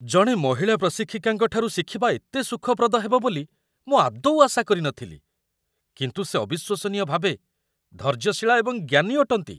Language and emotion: Odia, surprised